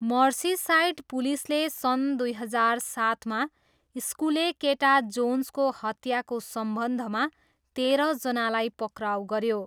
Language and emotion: Nepali, neutral